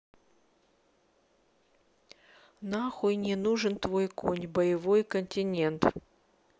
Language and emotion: Russian, neutral